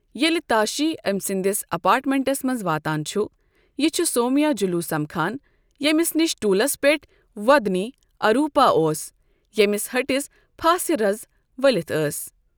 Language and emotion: Kashmiri, neutral